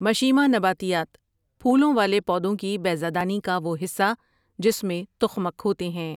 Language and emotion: Urdu, neutral